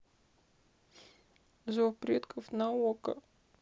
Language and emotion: Russian, sad